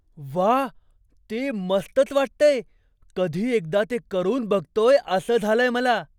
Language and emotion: Marathi, surprised